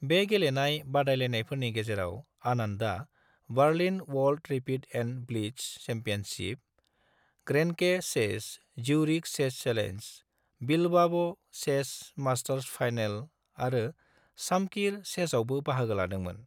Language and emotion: Bodo, neutral